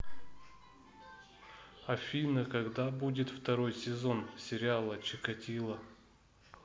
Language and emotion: Russian, neutral